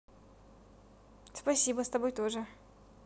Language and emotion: Russian, positive